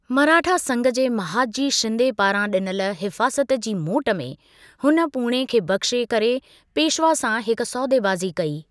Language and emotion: Sindhi, neutral